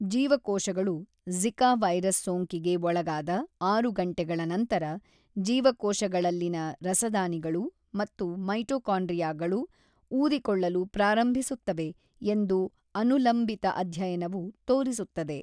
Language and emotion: Kannada, neutral